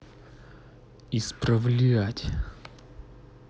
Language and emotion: Russian, angry